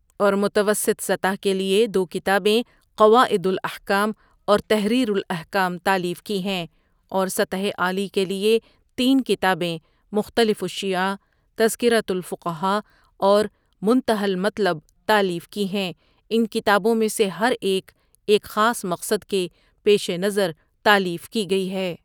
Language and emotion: Urdu, neutral